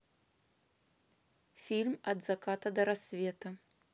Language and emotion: Russian, neutral